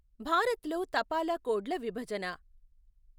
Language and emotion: Telugu, neutral